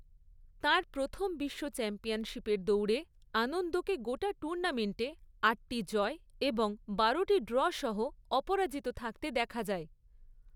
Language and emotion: Bengali, neutral